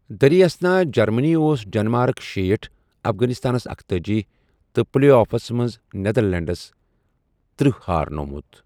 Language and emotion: Kashmiri, neutral